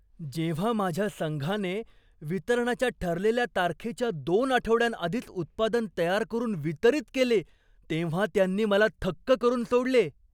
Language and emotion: Marathi, surprised